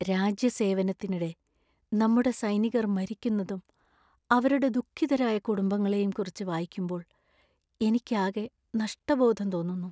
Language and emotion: Malayalam, sad